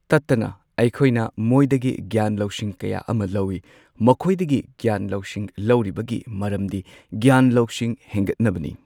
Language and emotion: Manipuri, neutral